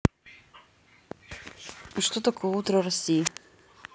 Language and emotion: Russian, neutral